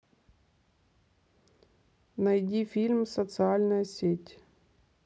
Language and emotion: Russian, neutral